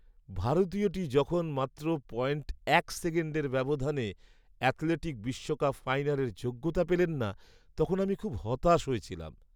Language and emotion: Bengali, sad